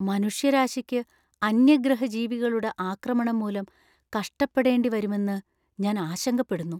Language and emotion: Malayalam, fearful